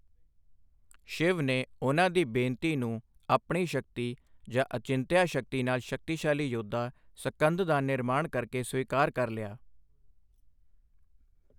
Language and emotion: Punjabi, neutral